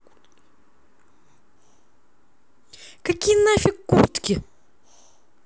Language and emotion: Russian, angry